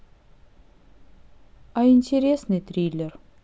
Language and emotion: Russian, neutral